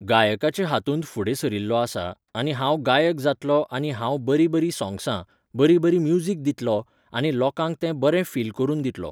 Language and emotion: Goan Konkani, neutral